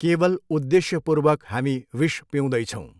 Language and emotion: Nepali, neutral